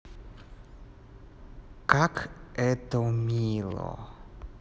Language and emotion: Russian, neutral